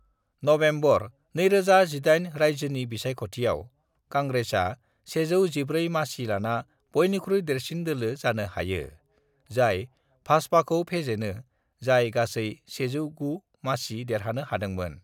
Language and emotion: Bodo, neutral